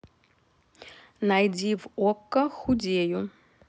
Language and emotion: Russian, neutral